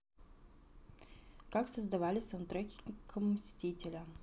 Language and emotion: Russian, neutral